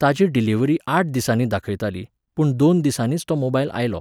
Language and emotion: Goan Konkani, neutral